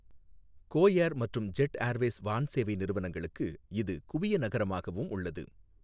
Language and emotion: Tamil, neutral